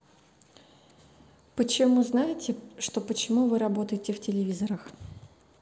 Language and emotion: Russian, neutral